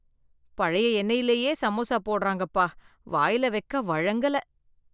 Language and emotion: Tamil, disgusted